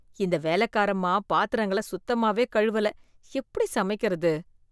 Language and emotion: Tamil, disgusted